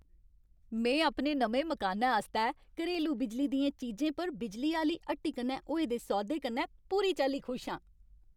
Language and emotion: Dogri, happy